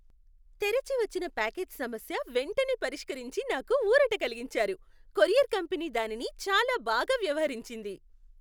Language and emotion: Telugu, happy